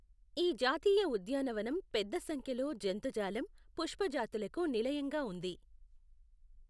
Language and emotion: Telugu, neutral